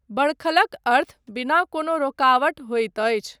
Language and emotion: Maithili, neutral